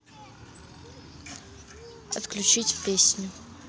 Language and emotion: Russian, neutral